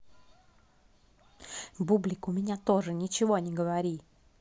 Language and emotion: Russian, angry